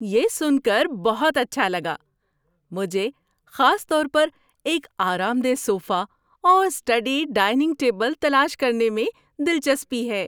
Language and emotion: Urdu, happy